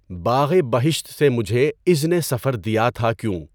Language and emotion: Urdu, neutral